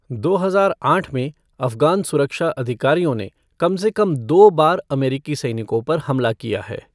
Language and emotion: Hindi, neutral